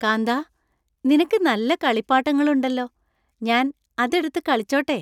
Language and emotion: Malayalam, happy